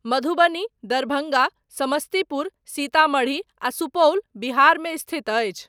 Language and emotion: Maithili, neutral